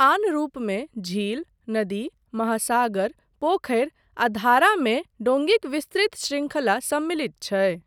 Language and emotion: Maithili, neutral